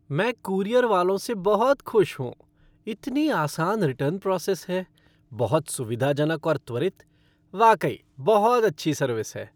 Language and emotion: Hindi, happy